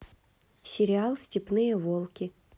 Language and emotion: Russian, neutral